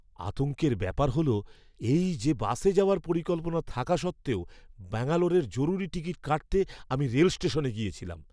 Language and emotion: Bengali, fearful